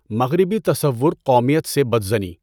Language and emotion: Urdu, neutral